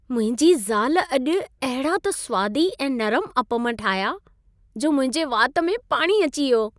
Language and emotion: Sindhi, happy